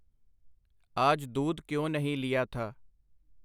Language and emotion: Punjabi, neutral